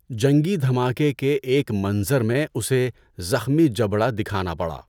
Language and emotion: Urdu, neutral